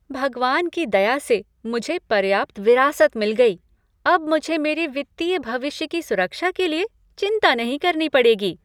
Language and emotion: Hindi, happy